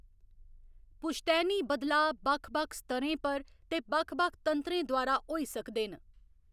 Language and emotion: Dogri, neutral